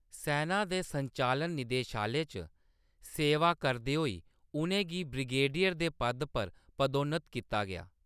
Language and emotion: Dogri, neutral